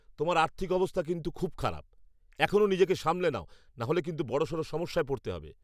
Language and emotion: Bengali, angry